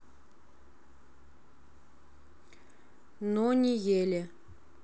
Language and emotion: Russian, neutral